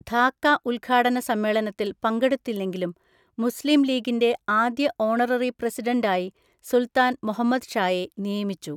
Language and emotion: Malayalam, neutral